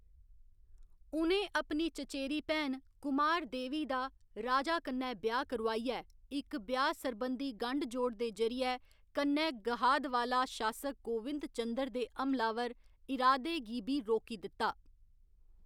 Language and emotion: Dogri, neutral